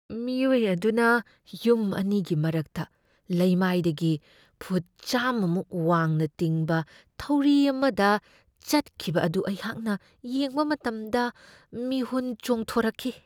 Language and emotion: Manipuri, fearful